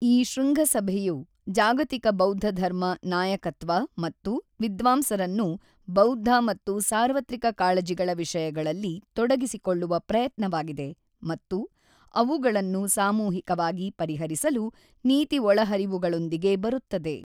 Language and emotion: Kannada, neutral